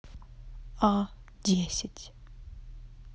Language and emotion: Russian, neutral